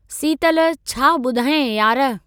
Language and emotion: Sindhi, neutral